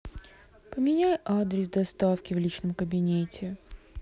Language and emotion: Russian, sad